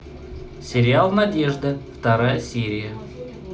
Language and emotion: Russian, neutral